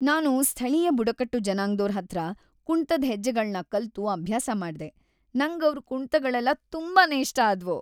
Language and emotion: Kannada, happy